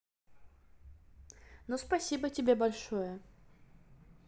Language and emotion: Russian, neutral